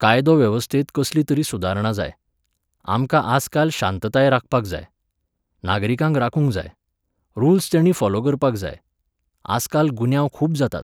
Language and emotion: Goan Konkani, neutral